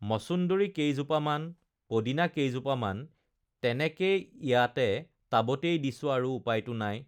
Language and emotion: Assamese, neutral